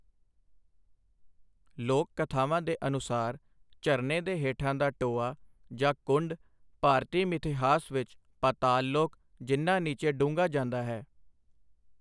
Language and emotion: Punjabi, neutral